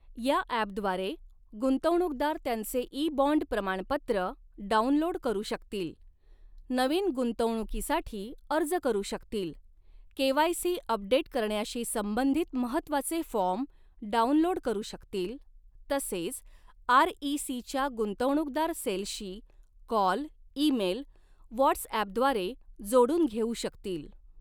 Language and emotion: Marathi, neutral